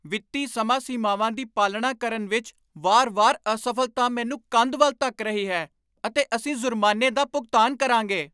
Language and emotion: Punjabi, angry